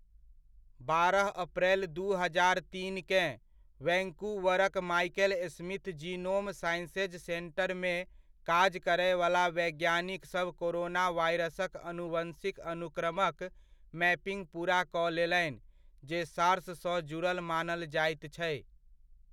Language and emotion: Maithili, neutral